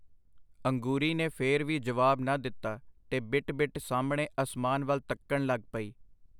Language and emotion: Punjabi, neutral